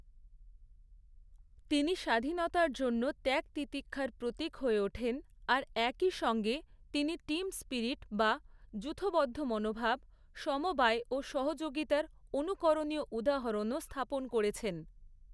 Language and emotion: Bengali, neutral